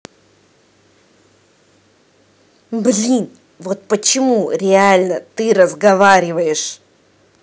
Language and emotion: Russian, angry